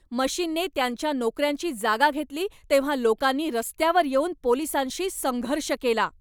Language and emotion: Marathi, angry